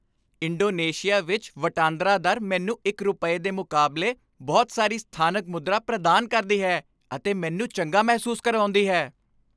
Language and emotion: Punjabi, happy